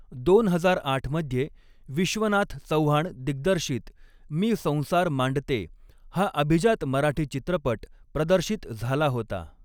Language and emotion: Marathi, neutral